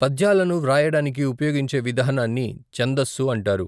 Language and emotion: Telugu, neutral